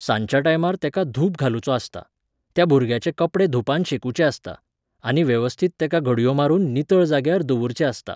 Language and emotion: Goan Konkani, neutral